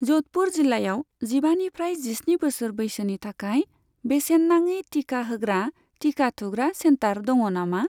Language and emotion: Bodo, neutral